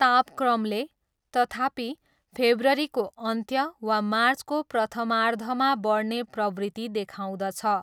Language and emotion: Nepali, neutral